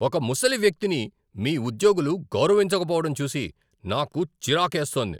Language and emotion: Telugu, angry